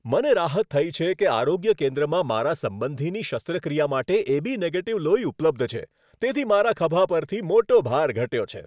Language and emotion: Gujarati, happy